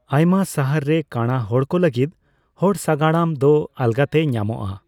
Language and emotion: Santali, neutral